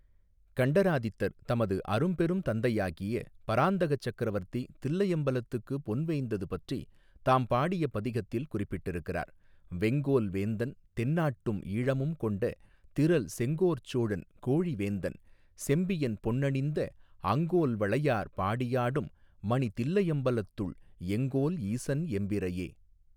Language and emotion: Tamil, neutral